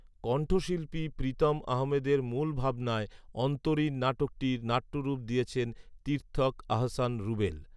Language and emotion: Bengali, neutral